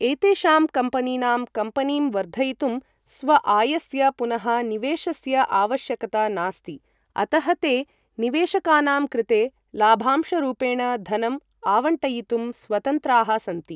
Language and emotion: Sanskrit, neutral